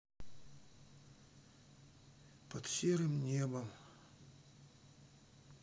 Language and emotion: Russian, sad